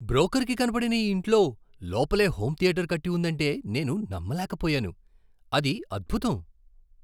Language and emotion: Telugu, surprised